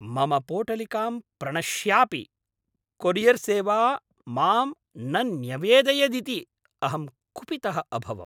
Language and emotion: Sanskrit, angry